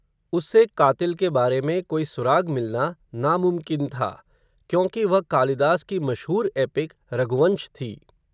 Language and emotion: Hindi, neutral